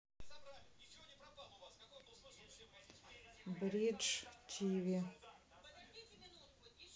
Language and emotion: Russian, neutral